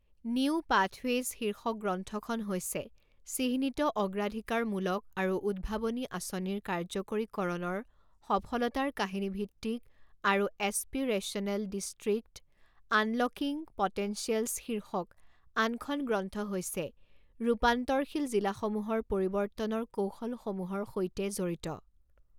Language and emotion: Assamese, neutral